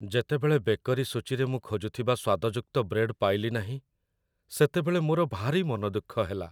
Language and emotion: Odia, sad